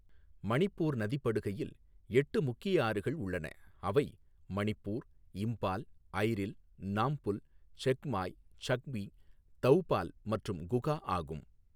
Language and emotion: Tamil, neutral